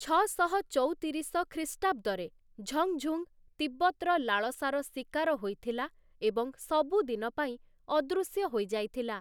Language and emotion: Odia, neutral